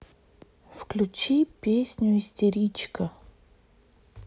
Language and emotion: Russian, neutral